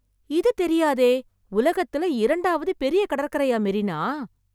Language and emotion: Tamil, surprised